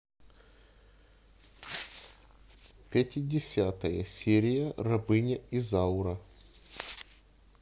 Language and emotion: Russian, neutral